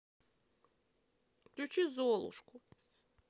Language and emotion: Russian, sad